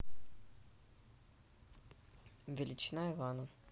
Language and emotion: Russian, neutral